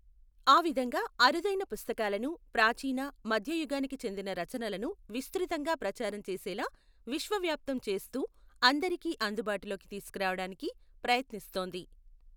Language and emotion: Telugu, neutral